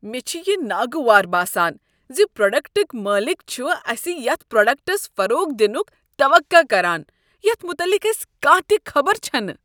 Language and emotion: Kashmiri, disgusted